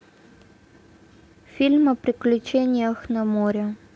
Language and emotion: Russian, neutral